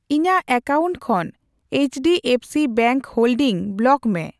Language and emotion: Santali, neutral